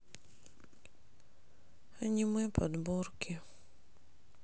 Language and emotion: Russian, sad